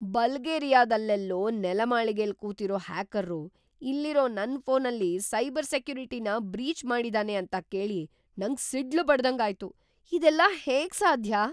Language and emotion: Kannada, surprised